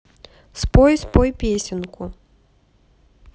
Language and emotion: Russian, neutral